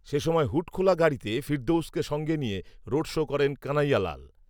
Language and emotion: Bengali, neutral